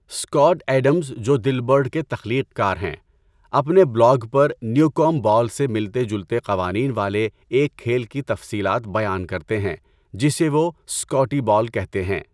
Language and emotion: Urdu, neutral